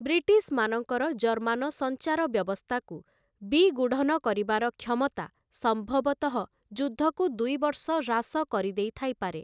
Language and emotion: Odia, neutral